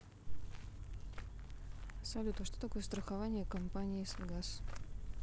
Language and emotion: Russian, neutral